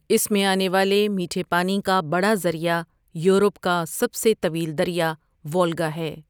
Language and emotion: Urdu, neutral